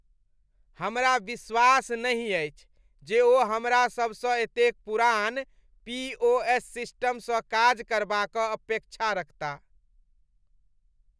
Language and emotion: Maithili, disgusted